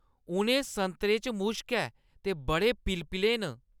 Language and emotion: Dogri, disgusted